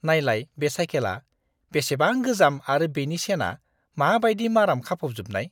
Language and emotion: Bodo, disgusted